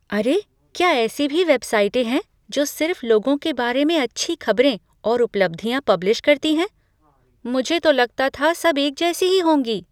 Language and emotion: Hindi, surprised